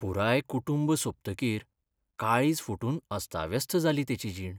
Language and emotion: Goan Konkani, sad